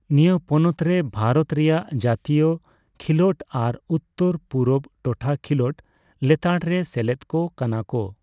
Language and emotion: Santali, neutral